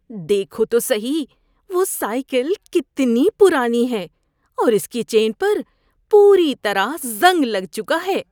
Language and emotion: Urdu, disgusted